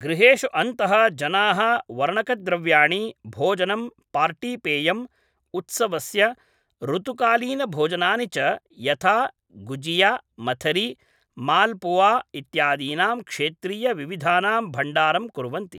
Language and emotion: Sanskrit, neutral